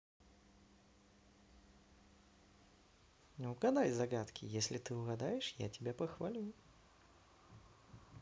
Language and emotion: Russian, positive